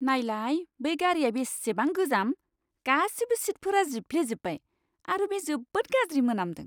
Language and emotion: Bodo, disgusted